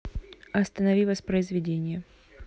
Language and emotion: Russian, neutral